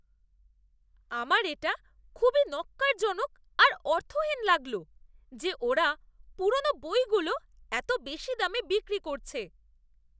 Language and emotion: Bengali, disgusted